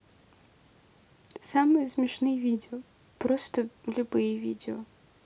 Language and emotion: Russian, neutral